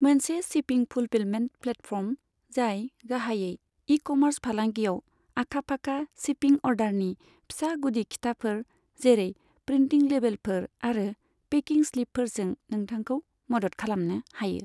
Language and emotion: Bodo, neutral